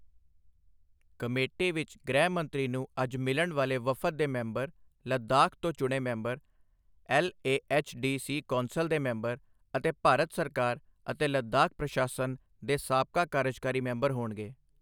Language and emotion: Punjabi, neutral